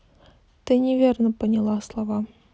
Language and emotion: Russian, neutral